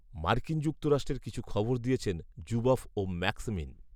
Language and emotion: Bengali, neutral